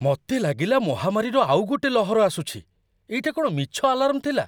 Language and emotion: Odia, surprised